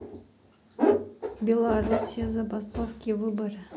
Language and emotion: Russian, neutral